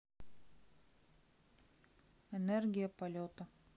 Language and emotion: Russian, neutral